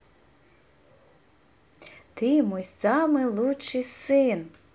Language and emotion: Russian, positive